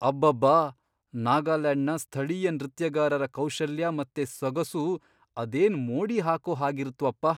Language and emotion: Kannada, surprised